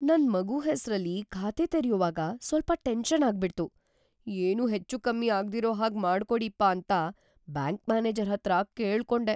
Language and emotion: Kannada, fearful